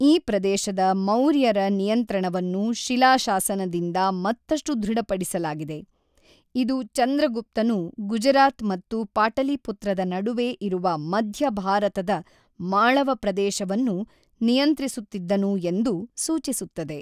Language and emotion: Kannada, neutral